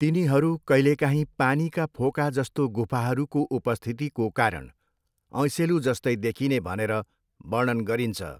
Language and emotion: Nepali, neutral